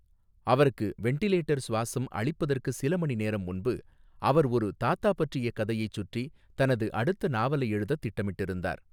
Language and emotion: Tamil, neutral